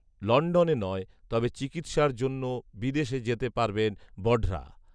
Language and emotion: Bengali, neutral